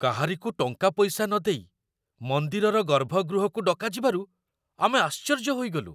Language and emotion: Odia, surprised